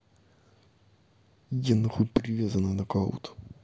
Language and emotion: Russian, angry